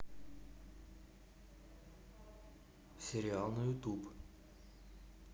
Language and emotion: Russian, neutral